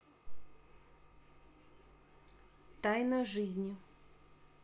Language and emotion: Russian, neutral